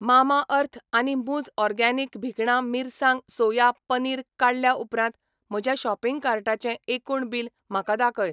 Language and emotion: Goan Konkani, neutral